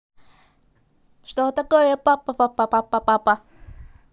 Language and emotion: Russian, positive